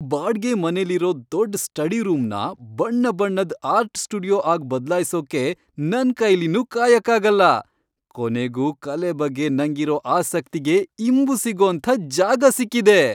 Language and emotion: Kannada, happy